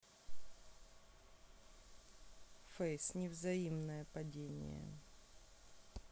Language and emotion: Russian, neutral